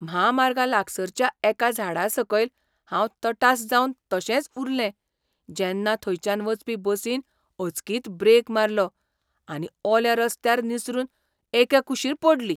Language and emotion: Goan Konkani, surprised